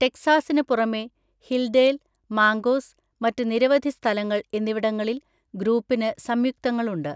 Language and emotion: Malayalam, neutral